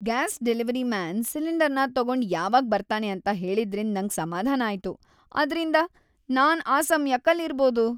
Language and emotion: Kannada, happy